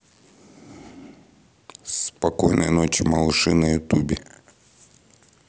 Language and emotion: Russian, neutral